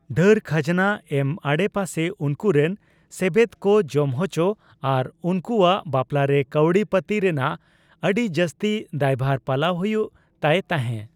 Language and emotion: Santali, neutral